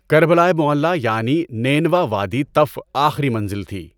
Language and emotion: Urdu, neutral